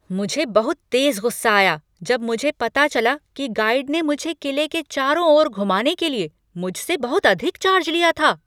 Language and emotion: Hindi, angry